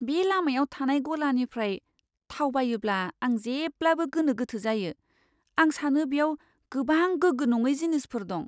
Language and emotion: Bodo, fearful